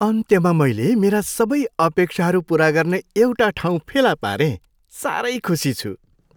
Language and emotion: Nepali, happy